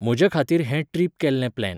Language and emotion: Goan Konkani, neutral